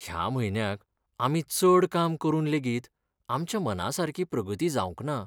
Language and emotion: Goan Konkani, sad